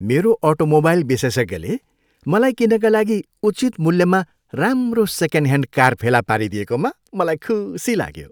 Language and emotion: Nepali, happy